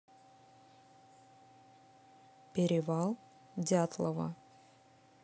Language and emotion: Russian, neutral